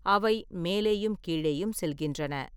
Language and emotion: Tamil, neutral